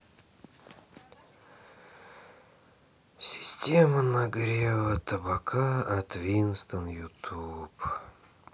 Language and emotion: Russian, sad